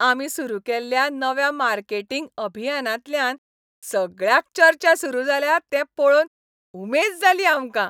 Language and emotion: Goan Konkani, happy